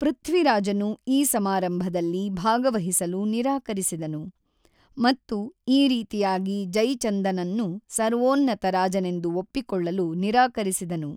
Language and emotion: Kannada, neutral